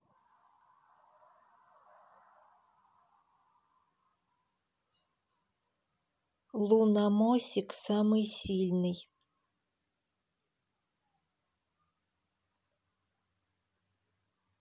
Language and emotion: Russian, neutral